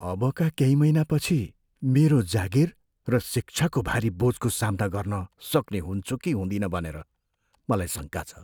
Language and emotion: Nepali, fearful